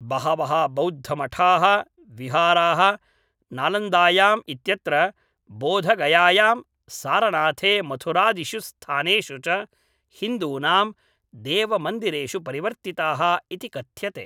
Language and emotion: Sanskrit, neutral